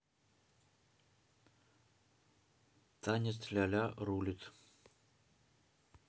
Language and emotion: Russian, neutral